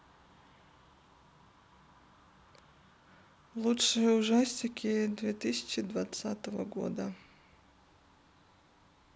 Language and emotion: Russian, neutral